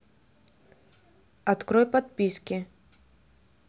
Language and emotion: Russian, neutral